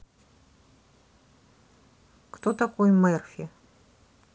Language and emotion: Russian, neutral